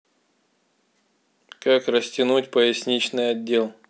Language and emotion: Russian, neutral